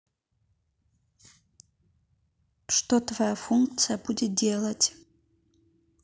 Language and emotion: Russian, neutral